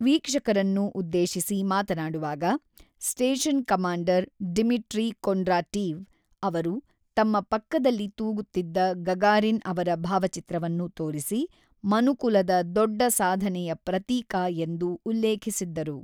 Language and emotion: Kannada, neutral